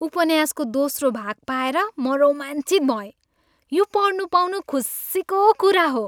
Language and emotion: Nepali, happy